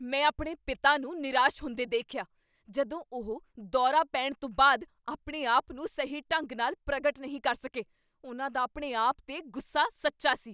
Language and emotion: Punjabi, angry